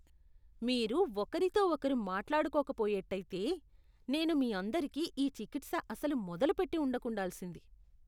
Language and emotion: Telugu, disgusted